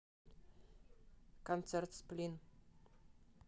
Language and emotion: Russian, neutral